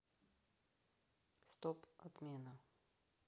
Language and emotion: Russian, neutral